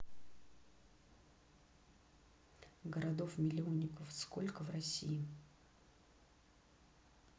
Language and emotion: Russian, neutral